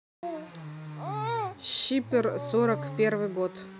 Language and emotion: Russian, neutral